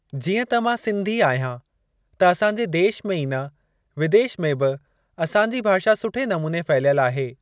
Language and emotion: Sindhi, neutral